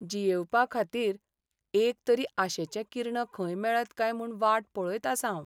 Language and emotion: Goan Konkani, sad